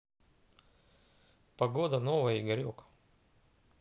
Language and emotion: Russian, neutral